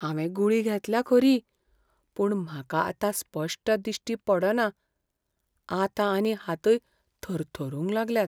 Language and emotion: Goan Konkani, fearful